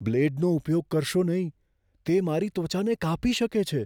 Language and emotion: Gujarati, fearful